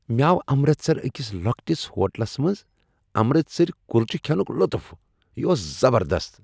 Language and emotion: Kashmiri, happy